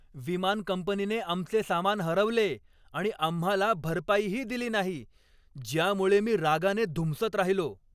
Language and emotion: Marathi, angry